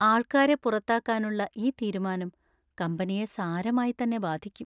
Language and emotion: Malayalam, sad